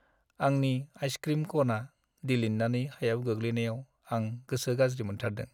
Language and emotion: Bodo, sad